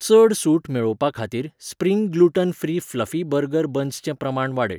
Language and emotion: Goan Konkani, neutral